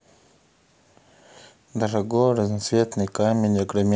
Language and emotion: Russian, neutral